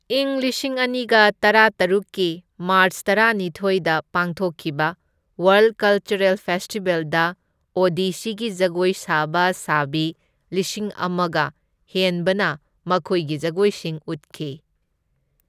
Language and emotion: Manipuri, neutral